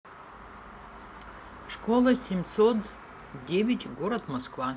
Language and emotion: Russian, neutral